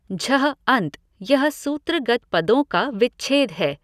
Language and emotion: Hindi, neutral